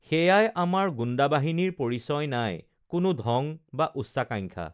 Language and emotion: Assamese, neutral